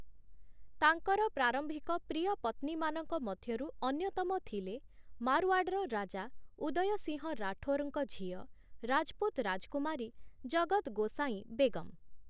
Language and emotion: Odia, neutral